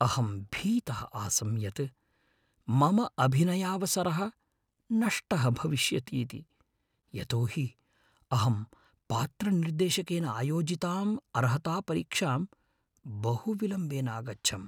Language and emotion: Sanskrit, fearful